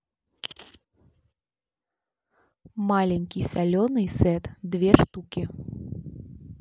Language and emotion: Russian, neutral